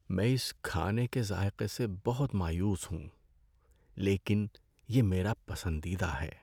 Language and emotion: Urdu, sad